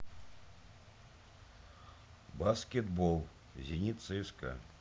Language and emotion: Russian, neutral